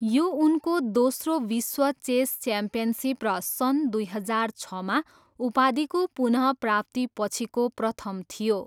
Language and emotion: Nepali, neutral